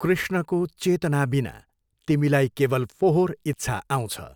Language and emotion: Nepali, neutral